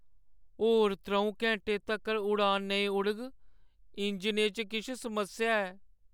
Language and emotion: Dogri, sad